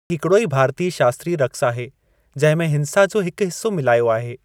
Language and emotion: Sindhi, neutral